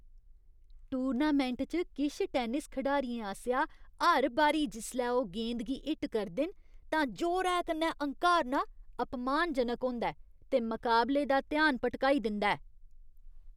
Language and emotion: Dogri, disgusted